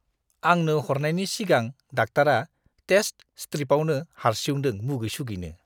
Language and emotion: Bodo, disgusted